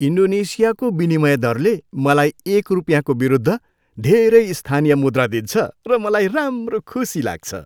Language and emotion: Nepali, happy